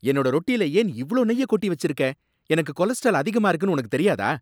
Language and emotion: Tamil, angry